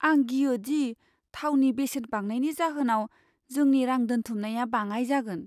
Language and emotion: Bodo, fearful